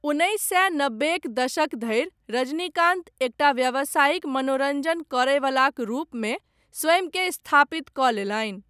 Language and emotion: Maithili, neutral